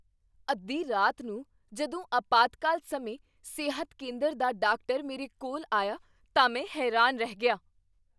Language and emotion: Punjabi, surprised